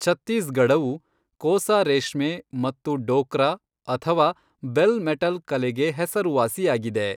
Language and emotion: Kannada, neutral